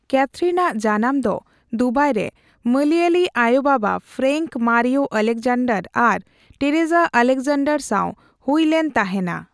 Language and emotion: Santali, neutral